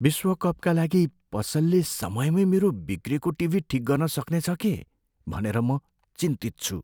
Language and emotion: Nepali, fearful